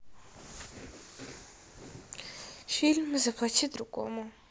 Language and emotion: Russian, sad